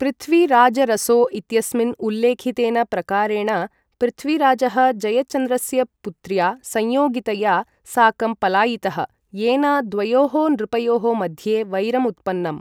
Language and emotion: Sanskrit, neutral